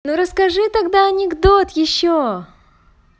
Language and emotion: Russian, positive